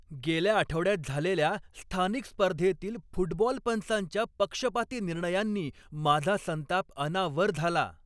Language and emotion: Marathi, angry